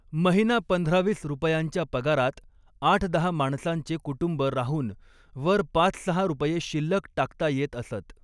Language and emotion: Marathi, neutral